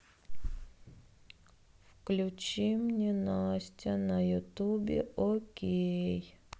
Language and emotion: Russian, sad